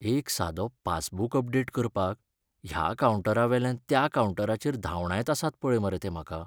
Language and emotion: Goan Konkani, sad